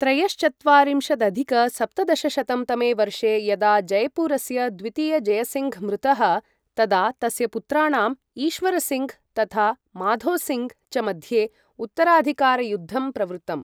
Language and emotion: Sanskrit, neutral